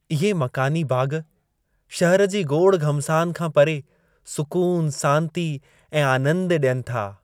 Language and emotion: Sindhi, happy